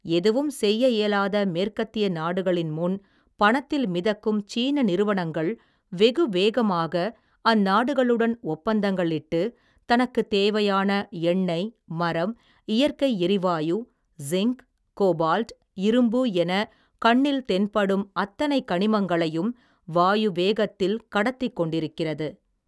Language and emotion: Tamil, neutral